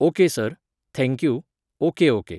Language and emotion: Goan Konkani, neutral